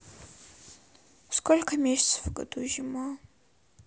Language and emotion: Russian, sad